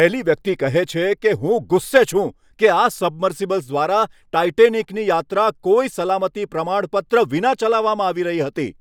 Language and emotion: Gujarati, angry